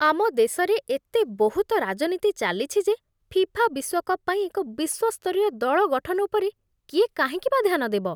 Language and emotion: Odia, disgusted